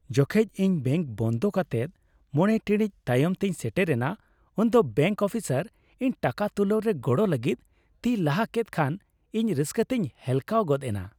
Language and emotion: Santali, happy